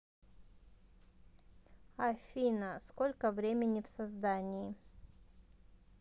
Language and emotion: Russian, neutral